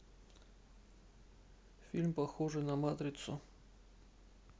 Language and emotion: Russian, neutral